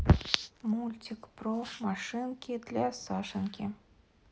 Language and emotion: Russian, neutral